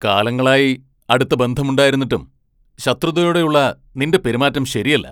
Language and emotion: Malayalam, angry